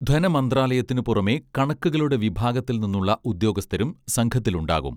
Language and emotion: Malayalam, neutral